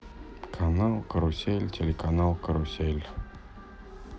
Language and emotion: Russian, sad